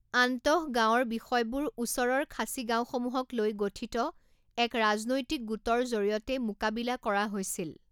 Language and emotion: Assamese, neutral